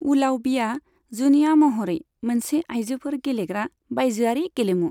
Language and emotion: Bodo, neutral